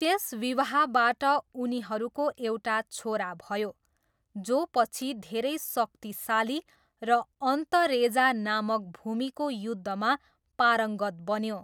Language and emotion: Nepali, neutral